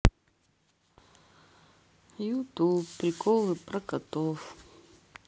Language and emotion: Russian, sad